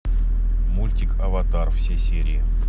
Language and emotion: Russian, neutral